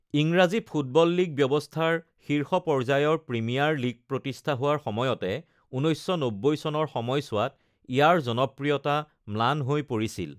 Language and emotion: Assamese, neutral